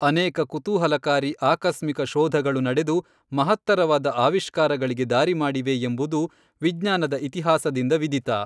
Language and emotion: Kannada, neutral